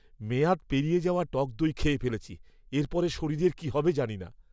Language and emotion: Bengali, disgusted